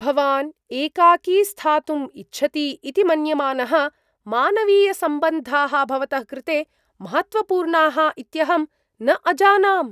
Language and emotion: Sanskrit, surprised